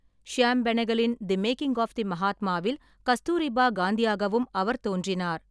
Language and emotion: Tamil, neutral